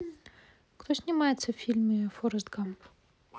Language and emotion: Russian, neutral